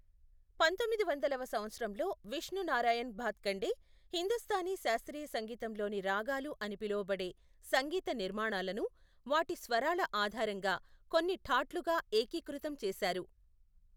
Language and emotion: Telugu, neutral